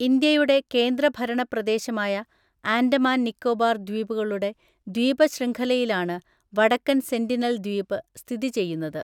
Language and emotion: Malayalam, neutral